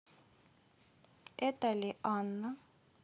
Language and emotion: Russian, neutral